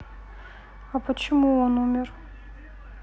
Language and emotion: Russian, sad